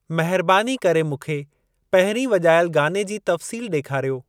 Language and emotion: Sindhi, neutral